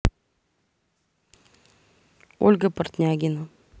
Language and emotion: Russian, neutral